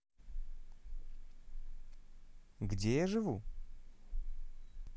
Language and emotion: Russian, neutral